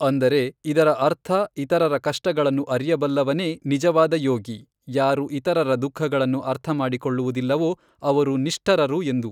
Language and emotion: Kannada, neutral